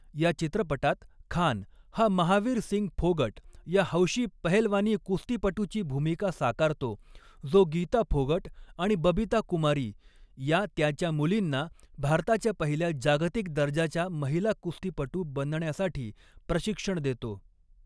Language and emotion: Marathi, neutral